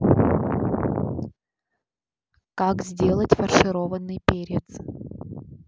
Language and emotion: Russian, neutral